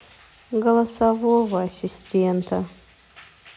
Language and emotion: Russian, sad